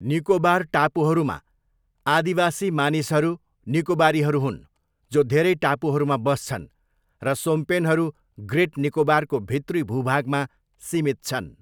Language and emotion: Nepali, neutral